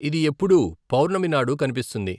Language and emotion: Telugu, neutral